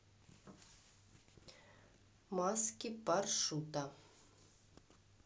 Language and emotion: Russian, neutral